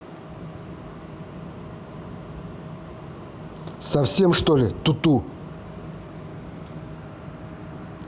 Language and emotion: Russian, angry